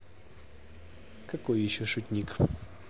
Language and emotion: Russian, neutral